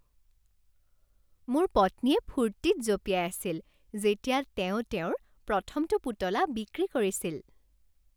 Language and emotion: Assamese, happy